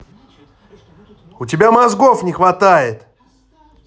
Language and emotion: Russian, angry